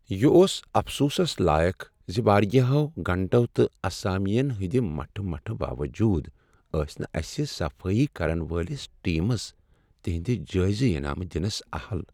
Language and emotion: Kashmiri, sad